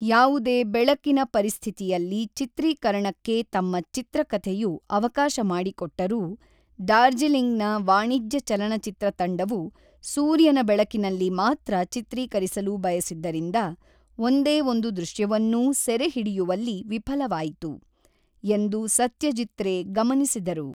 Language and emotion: Kannada, neutral